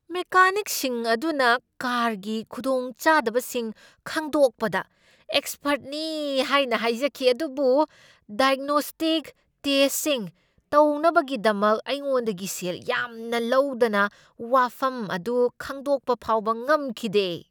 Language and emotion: Manipuri, angry